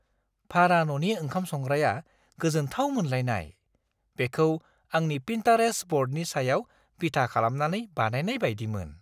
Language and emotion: Bodo, surprised